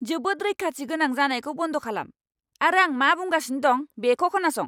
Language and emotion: Bodo, angry